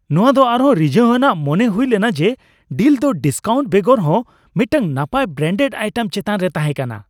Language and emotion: Santali, happy